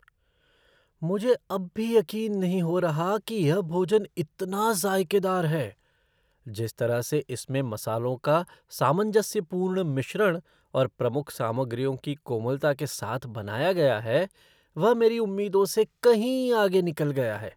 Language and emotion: Hindi, surprised